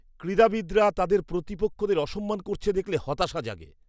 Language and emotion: Bengali, disgusted